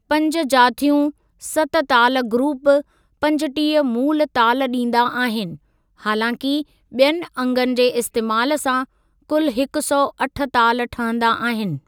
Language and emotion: Sindhi, neutral